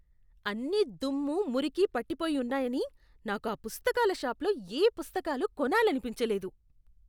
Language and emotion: Telugu, disgusted